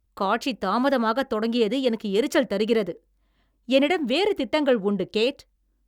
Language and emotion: Tamil, angry